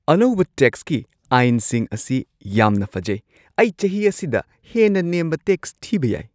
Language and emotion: Manipuri, surprised